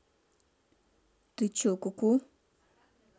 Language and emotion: Russian, neutral